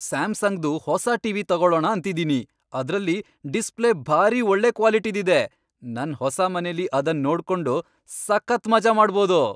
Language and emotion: Kannada, happy